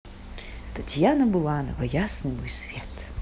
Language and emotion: Russian, positive